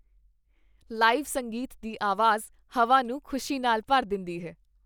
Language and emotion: Punjabi, happy